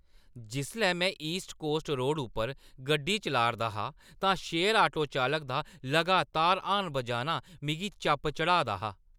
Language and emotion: Dogri, angry